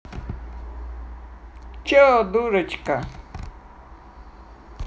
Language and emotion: Russian, neutral